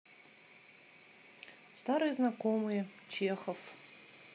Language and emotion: Russian, neutral